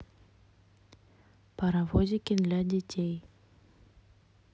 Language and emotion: Russian, neutral